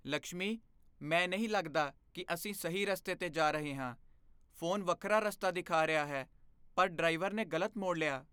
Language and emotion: Punjabi, fearful